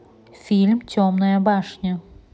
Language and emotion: Russian, neutral